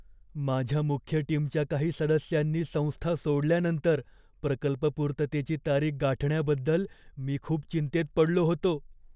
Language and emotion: Marathi, fearful